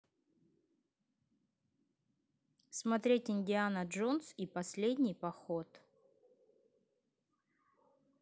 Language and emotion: Russian, neutral